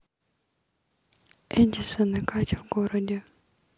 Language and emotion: Russian, neutral